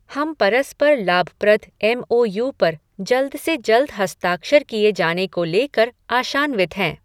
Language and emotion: Hindi, neutral